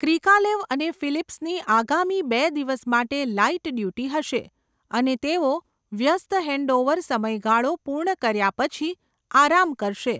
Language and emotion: Gujarati, neutral